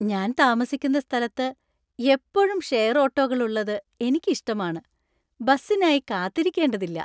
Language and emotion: Malayalam, happy